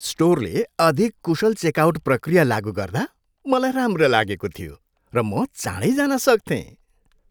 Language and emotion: Nepali, happy